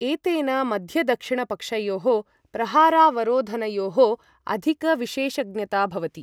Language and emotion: Sanskrit, neutral